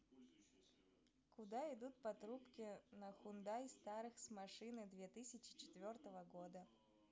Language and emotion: Russian, neutral